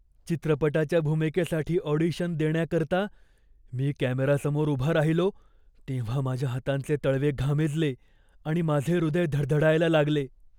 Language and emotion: Marathi, fearful